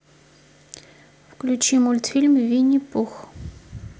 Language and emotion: Russian, neutral